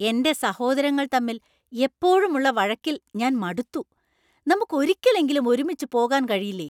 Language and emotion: Malayalam, angry